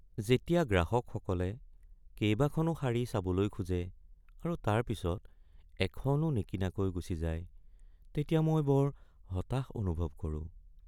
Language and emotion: Assamese, sad